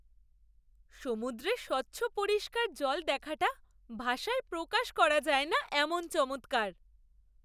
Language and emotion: Bengali, surprised